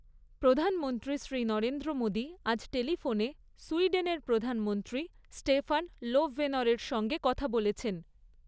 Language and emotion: Bengali, neutral